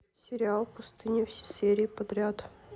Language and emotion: Russian, neutral